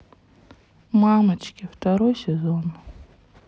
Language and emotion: Russian, sad